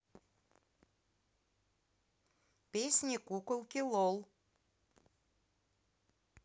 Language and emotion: Russian, neutral